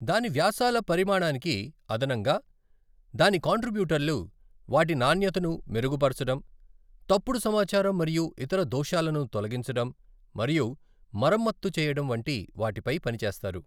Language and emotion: Telugu, neutral